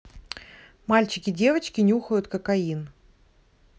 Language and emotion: Russian, neutral